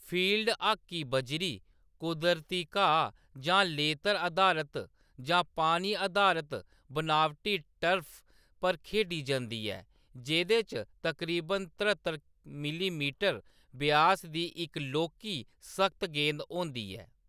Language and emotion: Dogri, neutral